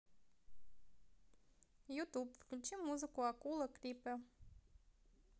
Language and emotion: Russian, positive